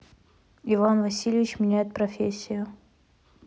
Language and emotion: Russian, neutral